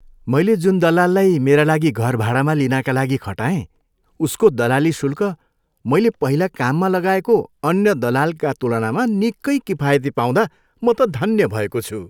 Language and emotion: Nepali, happy